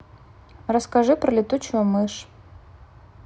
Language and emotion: Russian, neutral